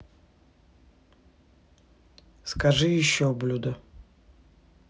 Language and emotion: Russian, neutral